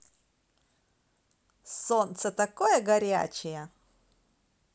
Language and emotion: Russian, positive